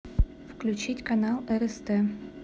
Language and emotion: Russian, neutral